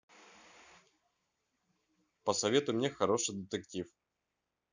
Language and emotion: Russian, neutral